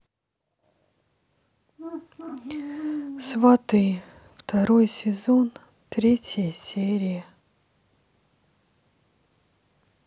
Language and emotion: Russian, sad